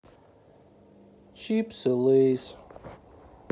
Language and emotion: Russian, sad